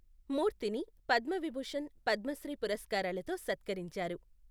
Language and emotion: Telugu, neutral